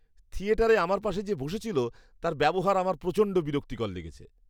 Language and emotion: Bengali, disgusted